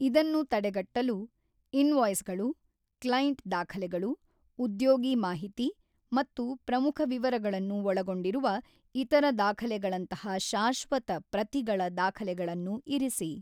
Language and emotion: Kannada, neutral